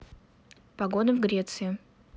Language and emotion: Russian, neutral